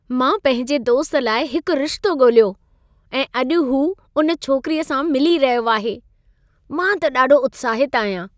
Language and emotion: Sindhi, happy